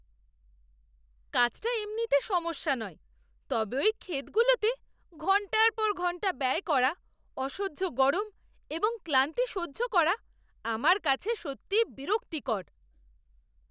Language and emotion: Bengali, disgusted